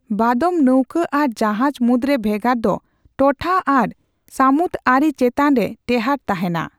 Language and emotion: Santali, neutral